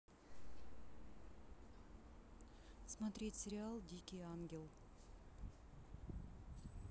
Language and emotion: Russian, neutral